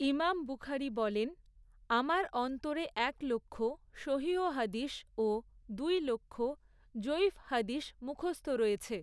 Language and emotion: Bengali, neutral